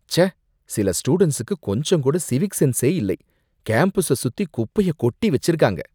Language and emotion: Tamil, disgusted